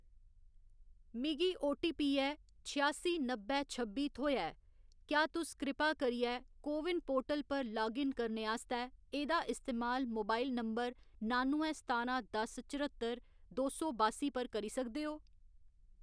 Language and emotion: Dogri, neutral